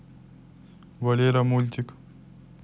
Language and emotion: Russian, neutral